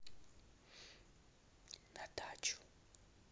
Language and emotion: Russian, neutral